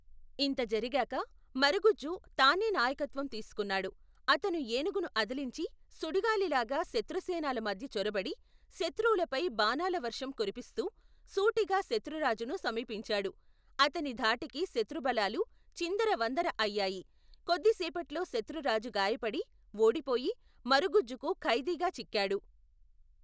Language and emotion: Telugu, neutral